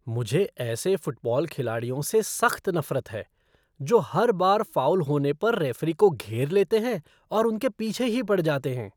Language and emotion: Hindi, disgusted